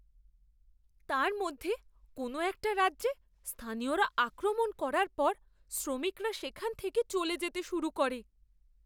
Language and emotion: Bengali, fearful